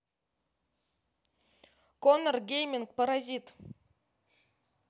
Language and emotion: Russian, neutral